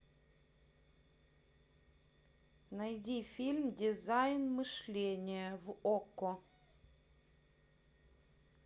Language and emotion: Russian, neutral